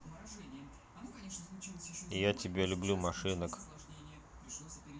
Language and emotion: Russian, neutral